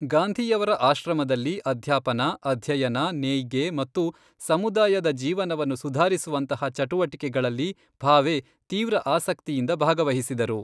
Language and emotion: Kannada, neutral